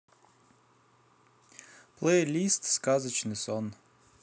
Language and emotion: Russian, neutral